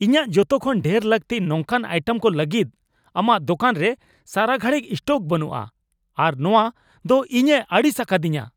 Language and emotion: Santali, angry